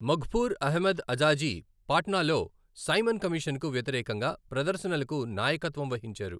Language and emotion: Telugu, neutral